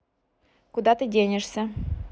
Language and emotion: Russian, neutral